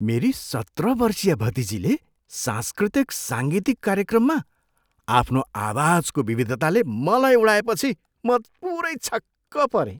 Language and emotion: Nepali, surprised